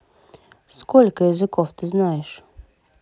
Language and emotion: Russian, neutral